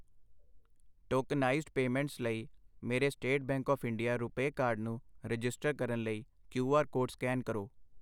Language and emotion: Punjabi, neutral